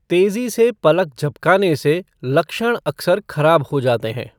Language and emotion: Hindi, neutral